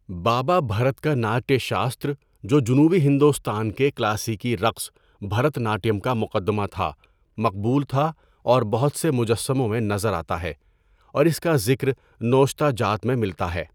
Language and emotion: Urdu, neutral